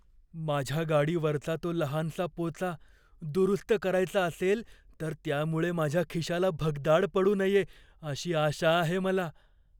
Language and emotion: Marathi, fearful